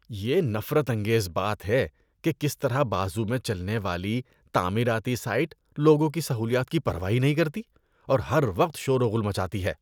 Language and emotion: Urdu, disgusted